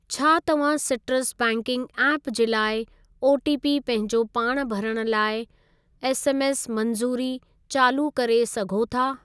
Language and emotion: Sindhi, neutral